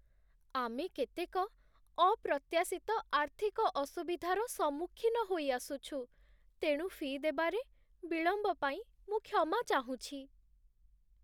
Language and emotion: Odia, sad